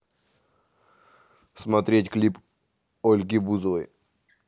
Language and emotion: Russian, neutral